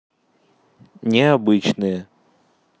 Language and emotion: Russian, neutral